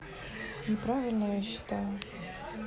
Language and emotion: Russian, neutral